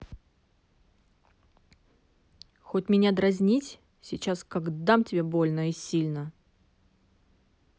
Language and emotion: Russian, angry